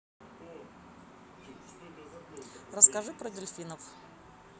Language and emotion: Russian, neutral